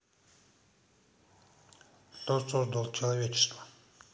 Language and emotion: Russian, neutral